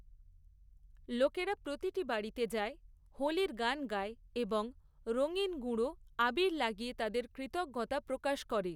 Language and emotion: Bengali, neutral